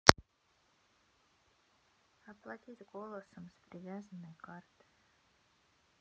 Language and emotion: Russian, sad